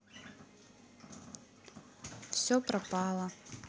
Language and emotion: Russian, sad